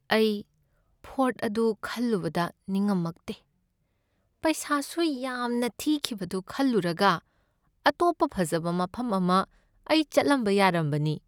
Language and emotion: Manipuri, sad